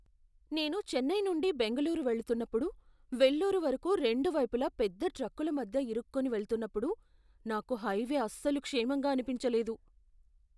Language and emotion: Telugu, fearful